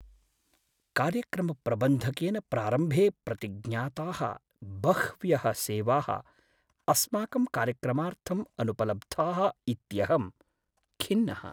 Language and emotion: Sanskrit, sad